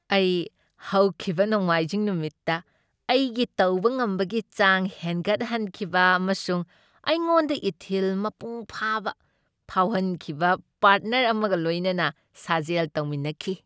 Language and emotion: Manipuri, happy